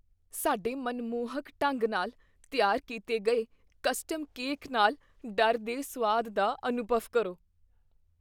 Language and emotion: Punjabi, fearful